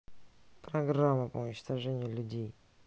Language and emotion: Russian, neutral